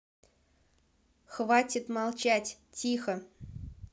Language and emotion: Russian, neutral